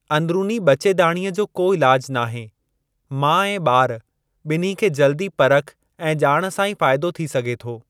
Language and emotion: Sindhi, neutral